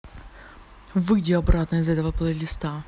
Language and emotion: Russian, angry